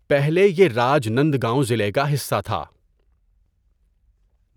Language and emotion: Urdu, neutral